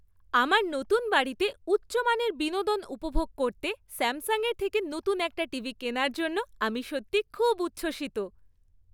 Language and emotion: Bengali, happy